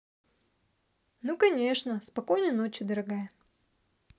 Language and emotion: Russian, positive